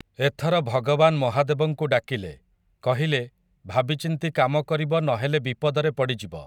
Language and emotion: Odia, neutral